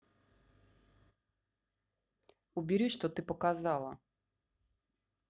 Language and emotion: Russian, angry